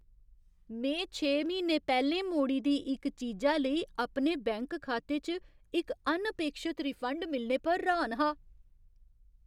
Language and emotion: Dogri, surprised